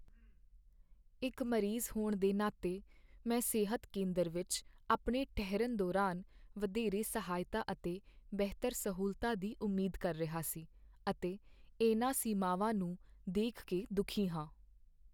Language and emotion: Punjabi, sad